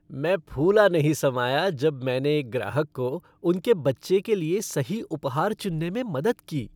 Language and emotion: Hindi, happy